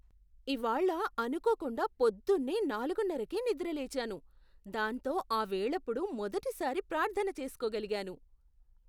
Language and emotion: Telugu, surprised